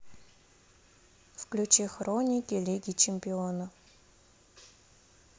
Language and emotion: Russian, neutral